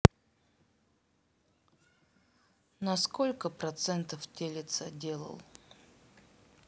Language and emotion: Russian, neutral